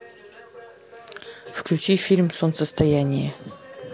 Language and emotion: Russian, neutral